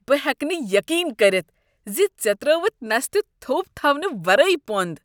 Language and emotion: Kashmiri, disgusted